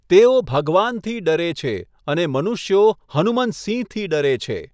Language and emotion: Gujarati, neutral